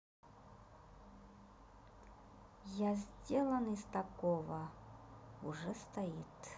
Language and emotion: Russian, neutral